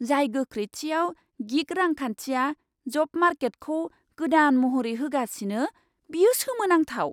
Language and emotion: Bodo, surprised